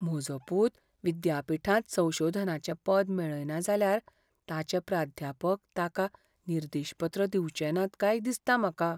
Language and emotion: Goan Konkani, fearful